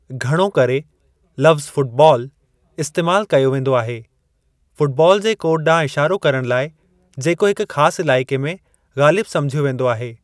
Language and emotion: Sindhi, neutral